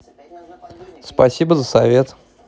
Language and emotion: Russian, positive